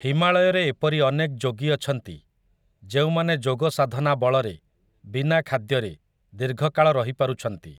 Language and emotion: Odia, neutral